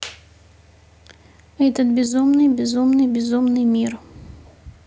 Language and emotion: Russian, neutral